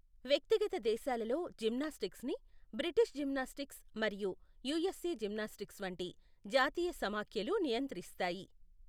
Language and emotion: Telugu, neutral